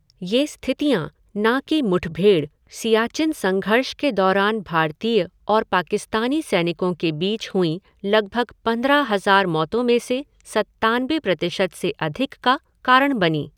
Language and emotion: Hindi, neutral